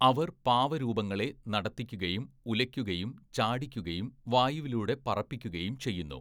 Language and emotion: Malayalam, neutral